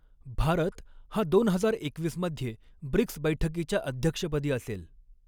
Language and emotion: Marathi, neutral